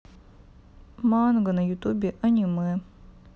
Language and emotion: Russian, sad